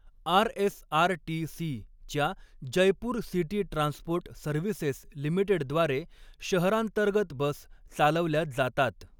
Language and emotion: Marathi, neutral